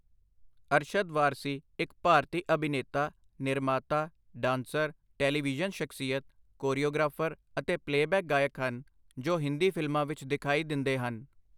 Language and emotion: Punjabi, neutral